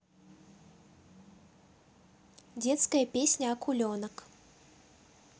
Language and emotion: Russian, neutral